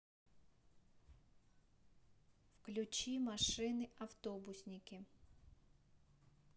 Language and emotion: Russian, neutral